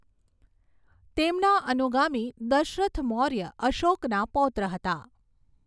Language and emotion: Gujarati, neutral